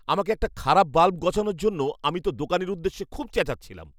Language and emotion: Bengali, angry